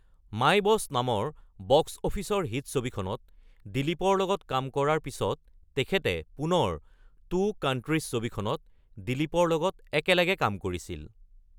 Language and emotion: Assamese, neutral